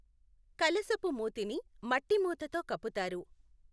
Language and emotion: Telugu, neutral